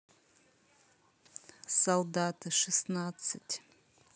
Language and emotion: Russian, neutral